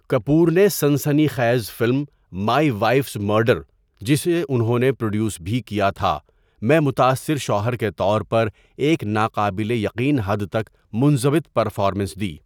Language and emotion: Urdu, neutral